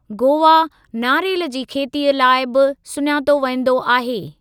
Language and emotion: Sindhi, neutral